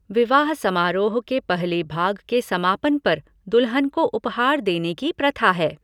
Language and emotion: Hindi, neutral